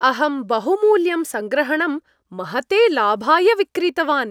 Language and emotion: Sanskrit, happy